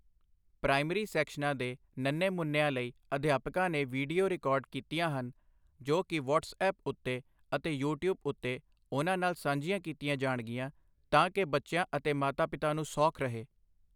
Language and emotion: Punjabi, neutral